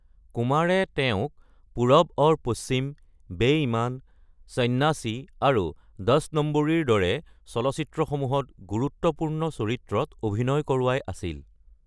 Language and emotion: Assamese, neutral